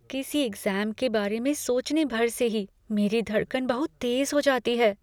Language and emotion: Hindi, fearful